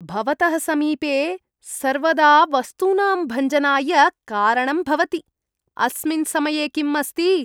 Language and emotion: Sanskrit, disgusted